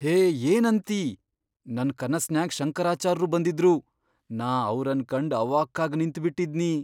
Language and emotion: Kannada, surprised